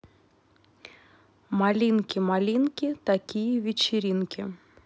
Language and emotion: Russian, neutral